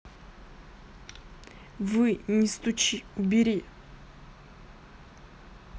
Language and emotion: Russian, neutral